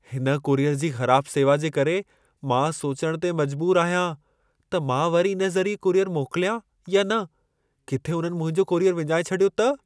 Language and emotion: Sindhi, fearful